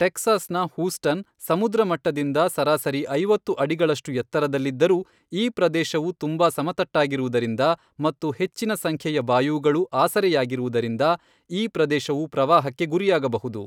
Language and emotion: Kannada, neutral